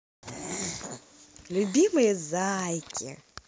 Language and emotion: Russian, positive